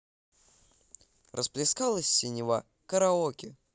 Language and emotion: Russian, positive